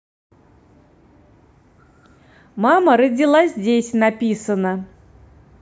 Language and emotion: Russian, positive